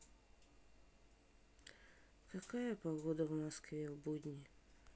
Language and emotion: Russian, sad